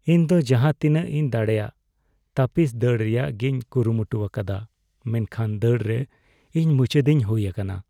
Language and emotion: Santali, sad